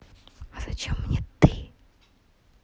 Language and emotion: Russian, neutral